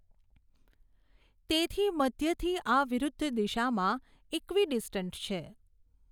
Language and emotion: Gujarati, neutral